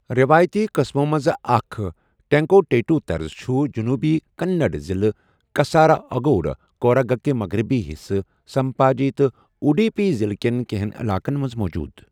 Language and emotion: Kashmiri, neutral